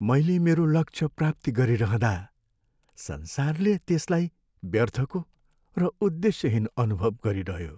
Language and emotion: Nepali, sad